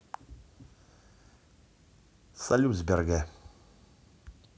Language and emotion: Russian, neutral